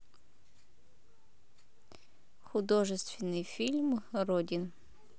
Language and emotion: Russian, neutral